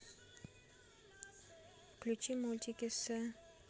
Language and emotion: Russian, neutral